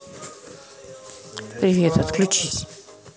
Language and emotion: Russian, neutral